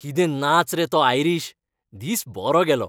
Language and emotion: Goan Konkani, happy